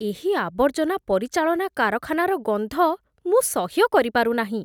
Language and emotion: Odia, disgusted